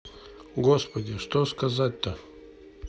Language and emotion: Russian, neutral